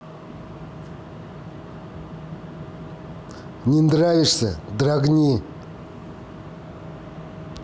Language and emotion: Russian, angry